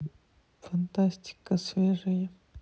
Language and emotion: Russian, sad